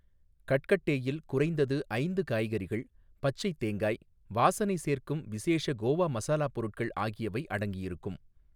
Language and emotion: Tamil, neutral